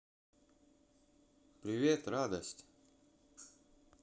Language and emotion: Russian, positive